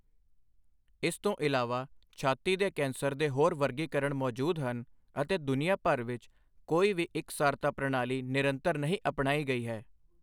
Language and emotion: Punjabi, neutral